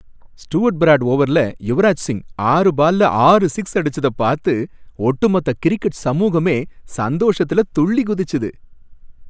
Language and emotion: Tamil, happy